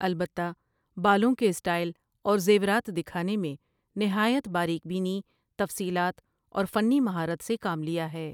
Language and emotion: Urdu, neutral